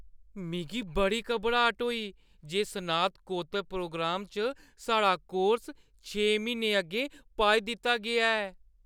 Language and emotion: Dogri, fearful